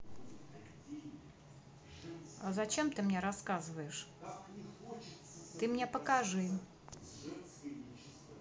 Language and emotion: Russian, neutral